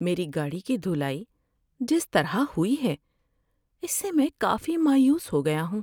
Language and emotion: Urdu, sad